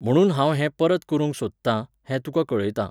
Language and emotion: Goan Konkani, neutral